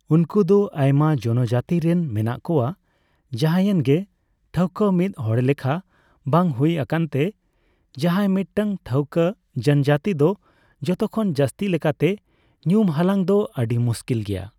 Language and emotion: Santali, neutral